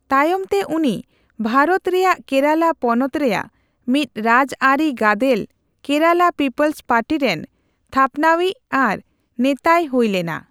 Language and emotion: Santali, neutral